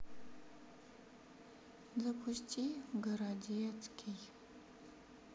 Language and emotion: Russian, sad